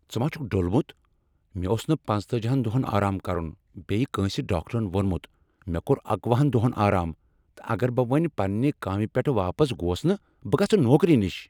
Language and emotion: Kashmiri, angry